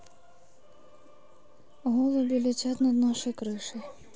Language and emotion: Russian, neutral